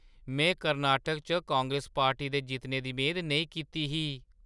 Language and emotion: Dogri, surprised